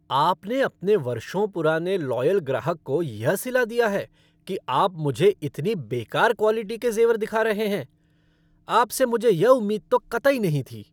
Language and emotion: Hindi, angry